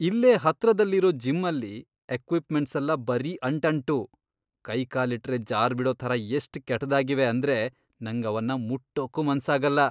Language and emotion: Kannada, disgusted